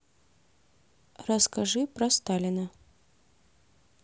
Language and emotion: Russian, neutral